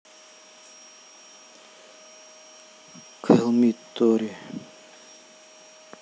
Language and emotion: Russian, neutral